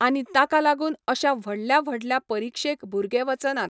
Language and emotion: Goan Konkani, neutral